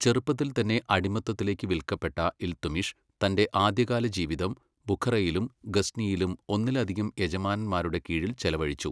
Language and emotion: Malayalam, neutral